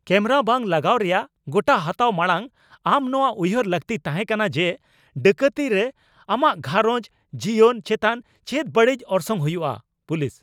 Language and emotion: Santali, angry